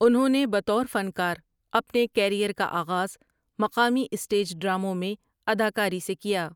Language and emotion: Urdu, neutral